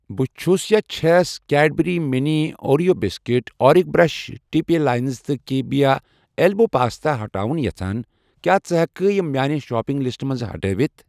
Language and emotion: Kashmiri, neutral